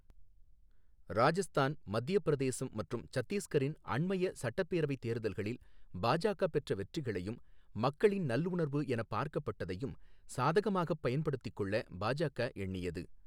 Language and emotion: Tamil, neutral